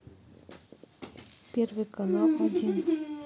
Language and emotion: Russian, neutral